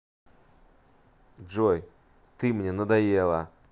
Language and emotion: Russian, angry